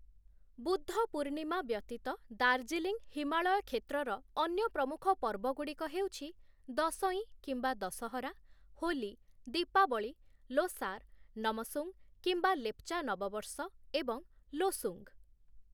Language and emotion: Odia, neutral